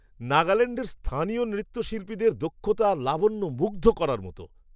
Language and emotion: Bengali, surprised